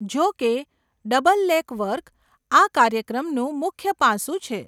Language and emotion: Gujarati, neutral